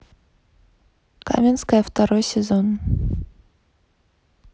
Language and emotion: Russian, neutral